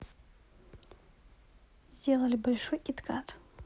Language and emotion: Russian, neutral